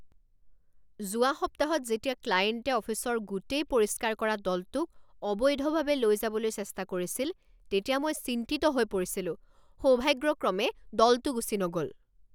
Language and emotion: Assamese, angry